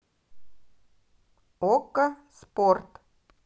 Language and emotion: Russian, neutral